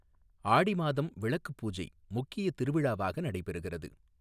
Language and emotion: Tamil, neutral